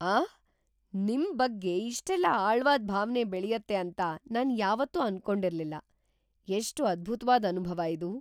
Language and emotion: Kannada, surprised